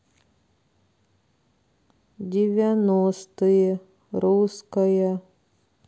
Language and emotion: Russian, sad